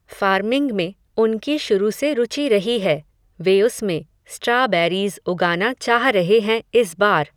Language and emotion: Hindi, neutral